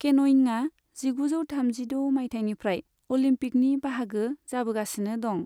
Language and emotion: Bodo, neutral